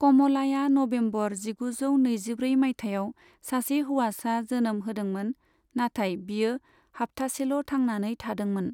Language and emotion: Bodo, neutral